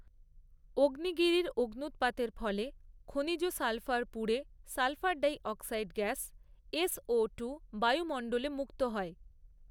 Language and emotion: Bengali, neutral